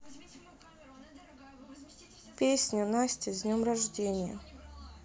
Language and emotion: Russian, sad